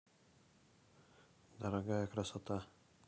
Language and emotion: Russian, neutral